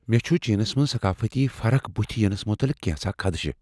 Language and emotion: Kashmiri, fearful